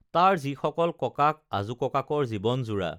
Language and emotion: Assamese, neutral